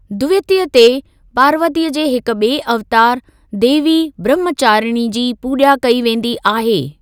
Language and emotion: Sindhi, neutral